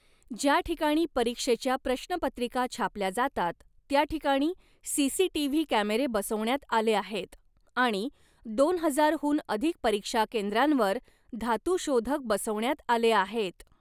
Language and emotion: Marathi, neutral